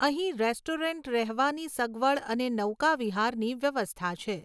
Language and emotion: Gujarati, neutral